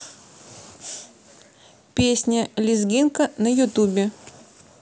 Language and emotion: Russian, neutral